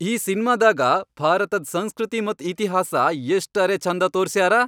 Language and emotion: Kannada, happy